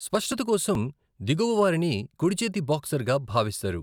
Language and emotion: Telugu, neutral